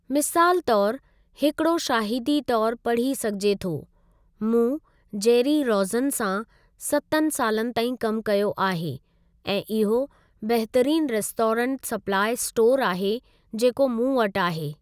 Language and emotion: Sindhi, neutral